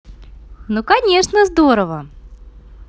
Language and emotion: Russian, positive